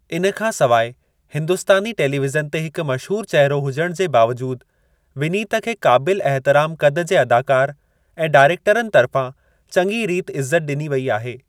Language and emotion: Sindhi, neutral